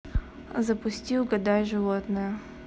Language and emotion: Russian, neutral